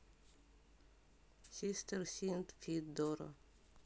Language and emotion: Russian, neutral